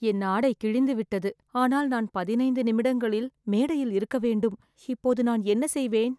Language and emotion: Tamil, fearful